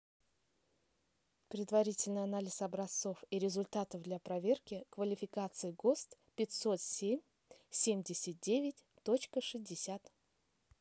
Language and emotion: Russian, neutral